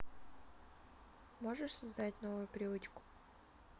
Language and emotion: Russian, neutral